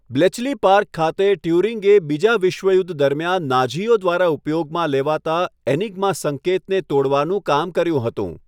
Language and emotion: Gujarati, neutral